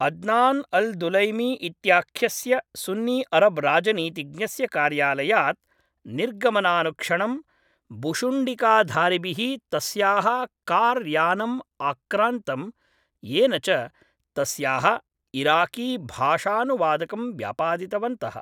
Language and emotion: Sanskrit, neutral